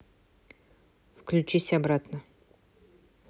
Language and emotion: Russian, neutral